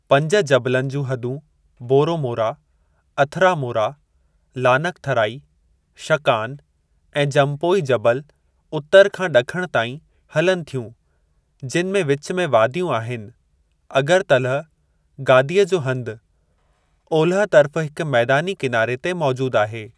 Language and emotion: Sindhi, neutral